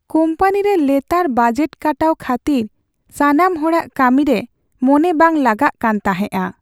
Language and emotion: Santali, sad